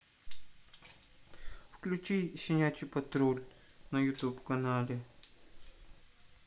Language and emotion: Russian, neutral